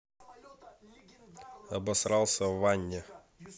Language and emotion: Russian, neutral